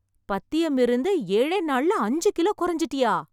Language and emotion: Tamil, surprised